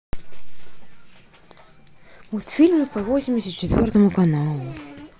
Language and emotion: Russian, sad